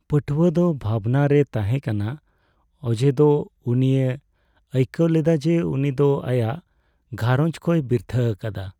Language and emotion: Santali, sad